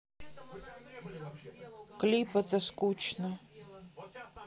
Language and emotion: Russian, sad